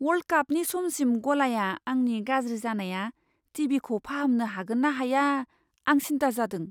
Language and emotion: Bodo, fearful